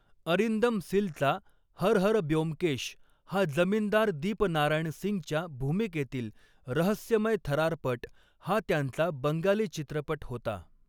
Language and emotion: Marathi, neutral